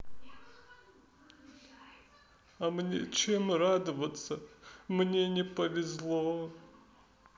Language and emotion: Russian, sad